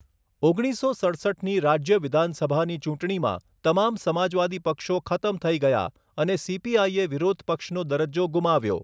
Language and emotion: Gujarati, neutral